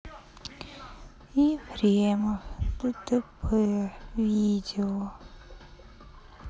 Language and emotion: Russian, sad